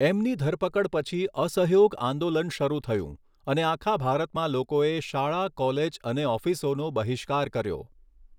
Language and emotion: Gujarati, neutral